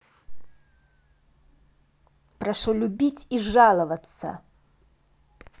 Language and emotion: Russian, angry